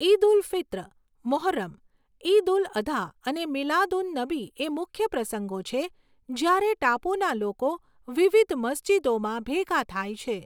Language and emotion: Gujarati, neutral